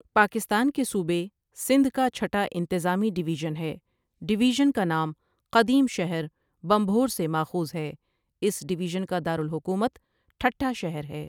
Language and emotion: Urdu, neutral